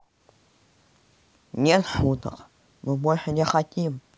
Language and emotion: Russian, sad